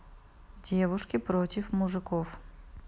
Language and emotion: Russian, neutral